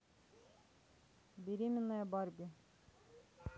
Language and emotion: Russian, neutral